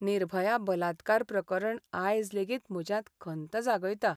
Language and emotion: Goan Konkani, sad